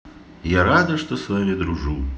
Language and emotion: Russian, positive